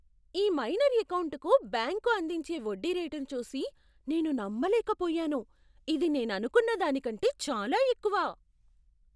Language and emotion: Telugu, surprised